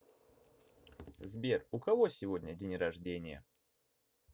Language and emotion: Russian, neutral